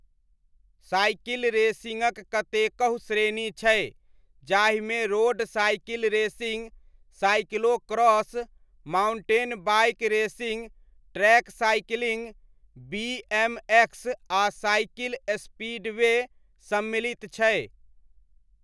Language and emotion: Maithili, neutral